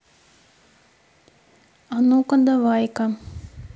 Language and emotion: Russian, neutral